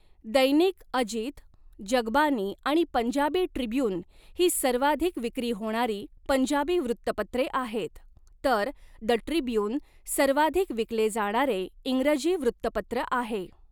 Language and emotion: Marathi, neutral